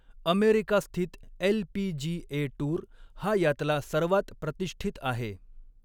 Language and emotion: Marathi, neutral